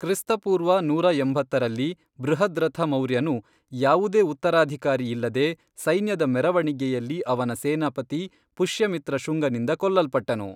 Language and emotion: Kannada, neutral